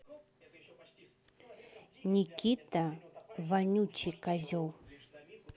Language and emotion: Russian, angry